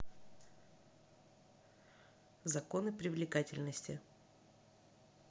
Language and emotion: Russian, neutral